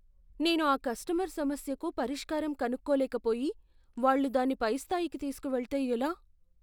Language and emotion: Telugu, fearful